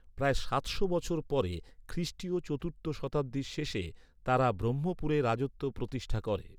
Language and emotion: Bengali, neutral